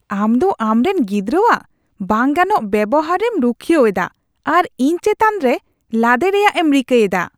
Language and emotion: Santali, disgusted